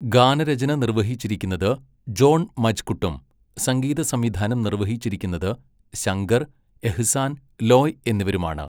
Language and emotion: Malayalam, neutral